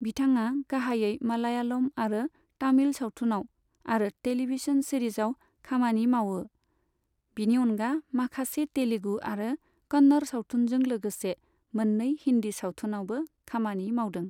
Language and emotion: Bodo, neutral